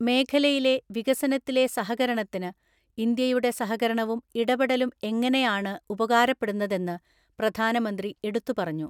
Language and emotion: Malayalam, neutral